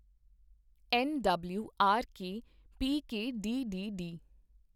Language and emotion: Punjabi, neutral